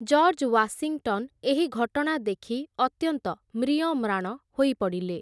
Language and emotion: Odia, neutral